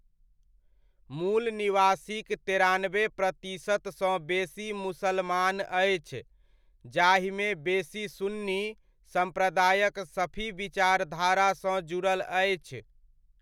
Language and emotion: Maithili, neutral